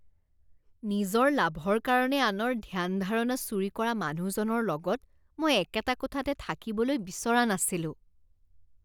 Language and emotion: Assamese, disgusted